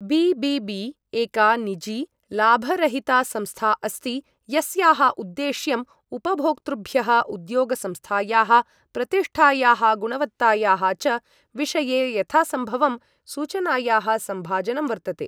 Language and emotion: Sanskrit, neutral